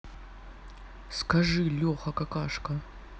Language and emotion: Russian, neutral